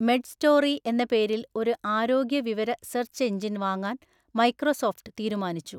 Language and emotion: Malayalam, neutral